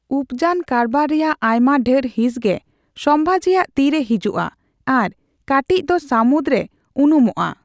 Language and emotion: Santali, neutral